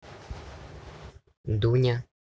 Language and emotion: Russian, neutral